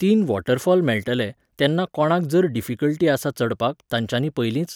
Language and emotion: Goan Konkani, neutral